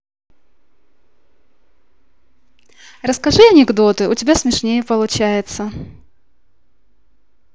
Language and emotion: Russian, positive